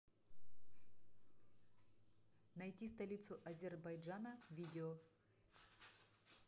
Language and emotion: Russian, neutral